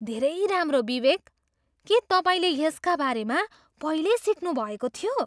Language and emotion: Nepali, surprised